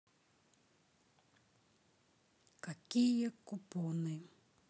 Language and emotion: Russian, sad